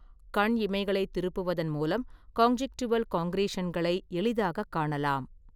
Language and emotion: Tamil, neutral